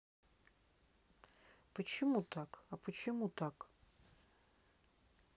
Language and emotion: Russian, sad